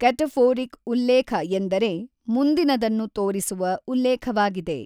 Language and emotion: Kannada, neutral